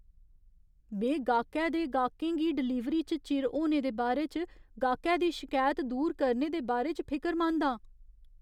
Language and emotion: Dogri, fearful